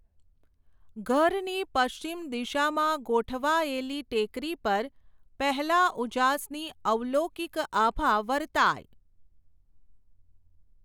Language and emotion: Gujarati, neutral